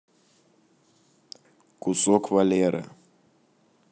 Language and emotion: Russian, neutral